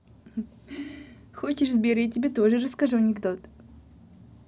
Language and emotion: Russian, positive